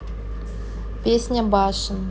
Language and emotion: Russian, neutral